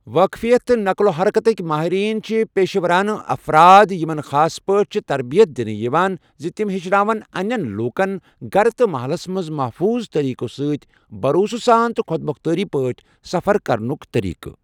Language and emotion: Kashmiri, neutral